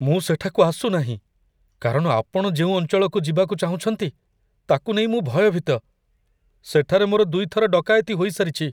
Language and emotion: Odia, fearful